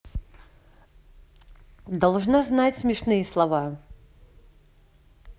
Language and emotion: Russian, neutral